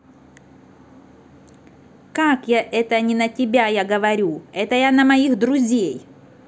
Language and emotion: Russian, angry